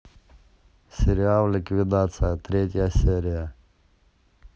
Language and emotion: Russian, neutral